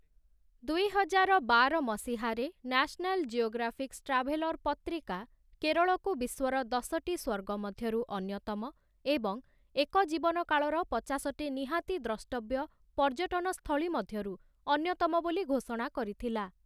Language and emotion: Odia, neutral